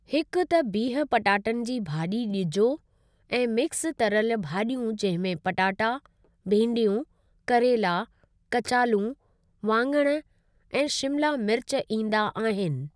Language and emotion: Sindhi, neutral